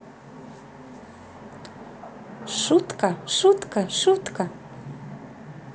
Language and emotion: Russian, positive